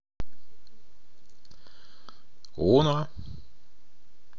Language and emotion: Russian, neutral